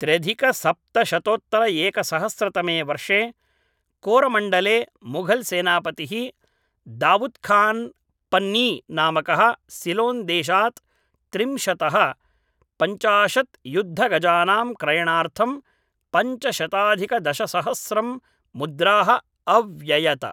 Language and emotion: Sanskrit, neutral